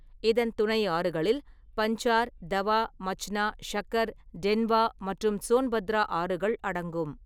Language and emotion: Tamil, neutral